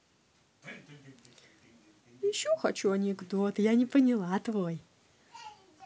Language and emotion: Russian, positive